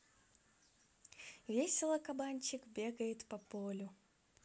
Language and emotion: Russian, positive